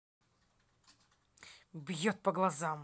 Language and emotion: Russian, angry